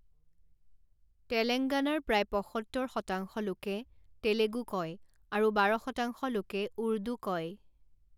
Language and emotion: Assamese, neutral